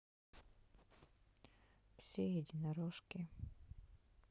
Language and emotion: Russian, sad